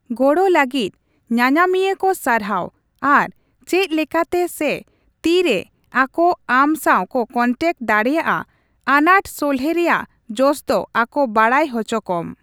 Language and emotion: Santali, neutral